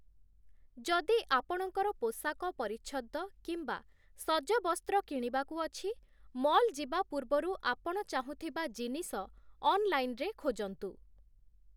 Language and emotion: Odia, neutral